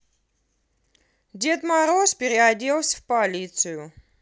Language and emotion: Russian, positive